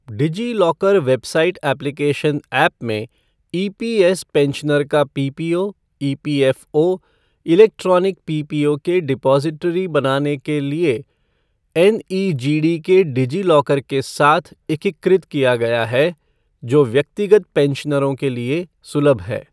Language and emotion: Hindi, neutral